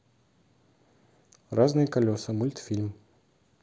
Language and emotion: Russian, neutral